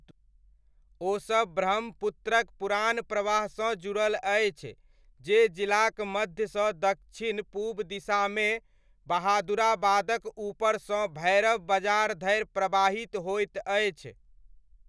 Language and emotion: Maithili, neutral